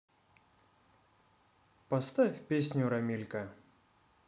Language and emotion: Russian, positive